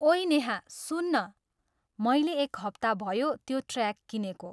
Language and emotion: Nepali, neutral